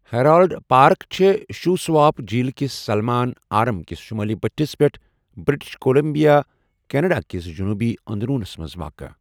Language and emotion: Kashmiri, neutral